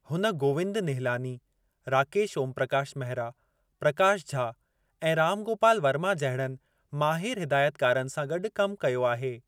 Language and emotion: Sindhi, neutral